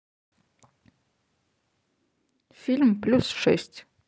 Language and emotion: Russian, neutral